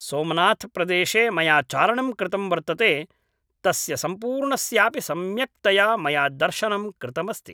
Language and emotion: Sanskrit, neutral